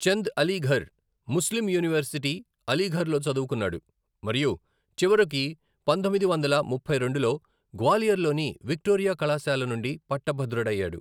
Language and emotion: Telugu, neutral